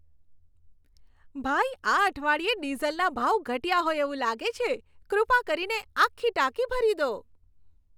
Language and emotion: Gujarati, happy